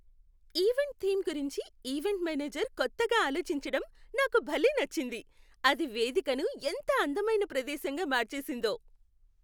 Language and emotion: Telugu, happy